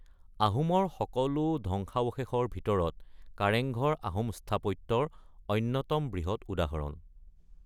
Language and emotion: Assamese, neutral